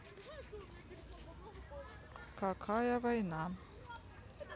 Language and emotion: Russian, neutral